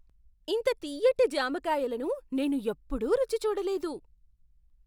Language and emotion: Telugu, surprised